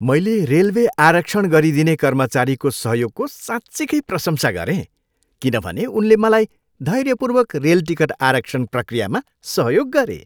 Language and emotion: Nepali, happy